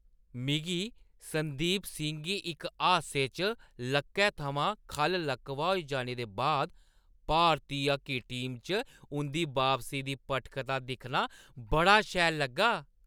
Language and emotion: Dogri, happy